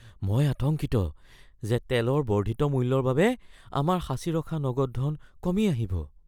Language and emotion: Assamese, fearful